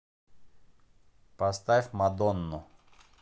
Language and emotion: Russian, neutral